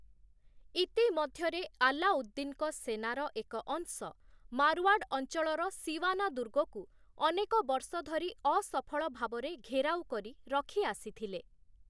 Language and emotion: Odia, neutral